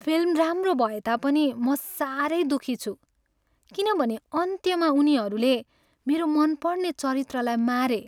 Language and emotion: Nepali, sad